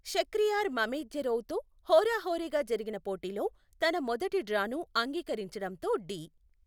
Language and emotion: Telugu, neutral